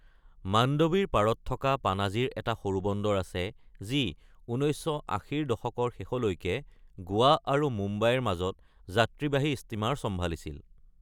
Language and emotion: Assamese, neutral